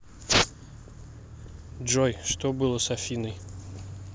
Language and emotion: Russian, neutral